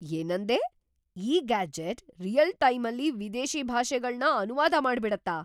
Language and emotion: Kannada, surprised